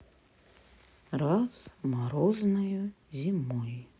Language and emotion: Russian, sad